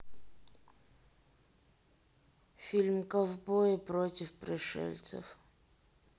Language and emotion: Russian, neutral